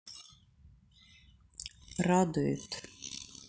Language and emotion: Russian, neutral